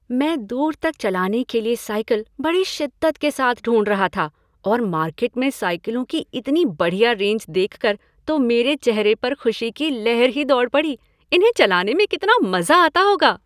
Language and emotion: Hindi, happy